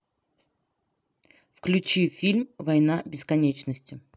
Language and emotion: Russian, neutral